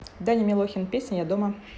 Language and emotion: Russian, neutral